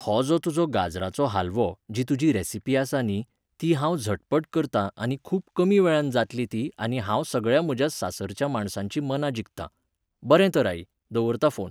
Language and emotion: Goan Konkani, neutral